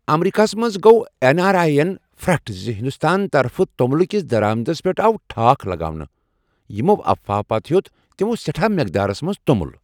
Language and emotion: Kashmiri, surprised